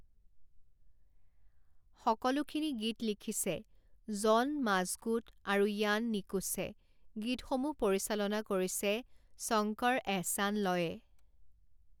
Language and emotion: Assamese, neutral